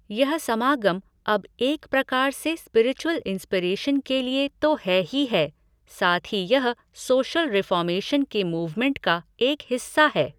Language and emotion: Hindi, neutral